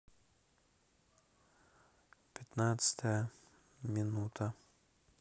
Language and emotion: Russian, neutral